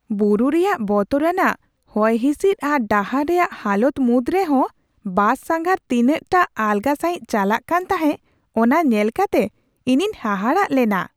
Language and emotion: Santali, surprised